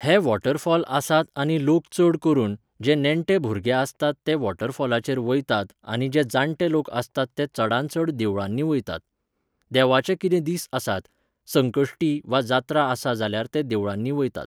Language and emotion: Goan Konkani, neutral